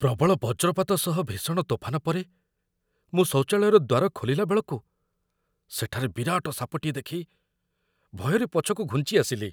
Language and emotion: Odia, fearful